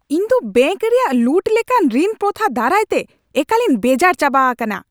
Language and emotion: Santali, angry